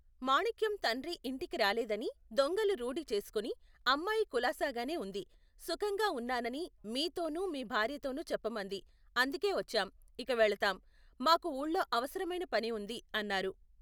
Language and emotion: Telugu, neutral